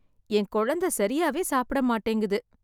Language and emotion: Tamil, sad